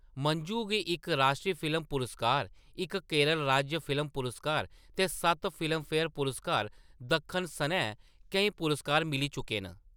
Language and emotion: Dogri, neutral